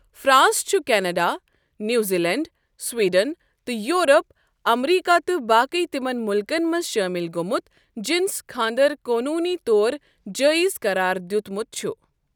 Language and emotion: Kashmiri, neutral